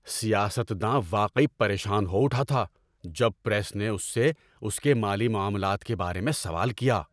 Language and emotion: Urdu, angry